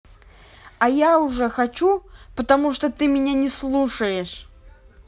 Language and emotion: Russian, angry